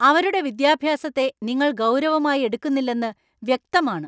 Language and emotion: Malayalam, angry